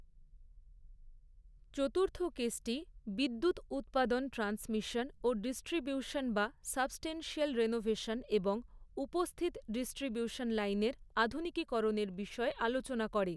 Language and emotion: Bengali, neutral